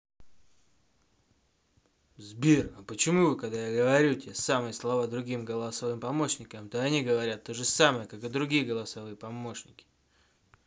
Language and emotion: Russian, angry